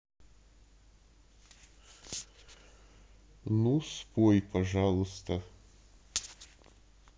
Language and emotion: Russian, neutral